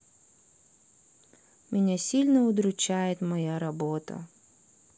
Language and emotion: Russian, sad